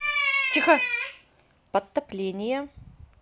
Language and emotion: Russian, neutral